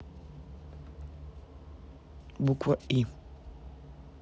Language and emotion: Russian, neutral